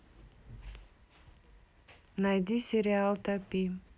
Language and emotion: Russian, neutral